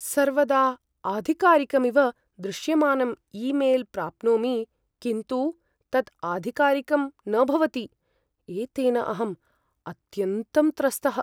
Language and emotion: Sanskrit, fearful